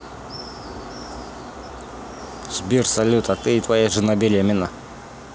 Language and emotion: Russian, neutral